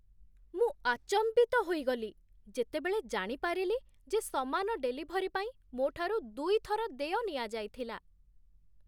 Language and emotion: Odia, surprised